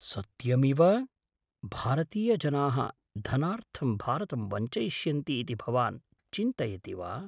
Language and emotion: Sanskrit, surprised